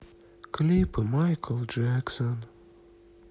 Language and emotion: Russian, sad